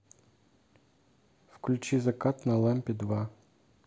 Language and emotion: Russian, neutral